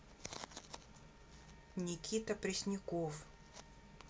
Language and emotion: Russian, neutral